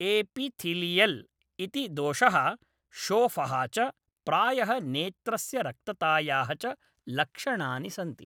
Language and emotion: Sanskrit, neutral